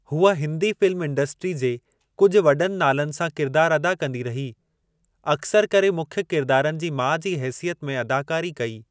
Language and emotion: Sindhi, neutral